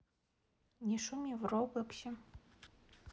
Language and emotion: Russian, neutral